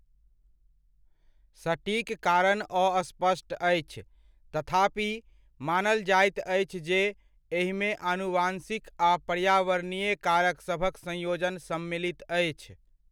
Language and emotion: Maithili, neutral